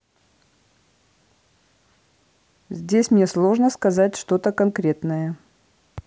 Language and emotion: Russian, neutral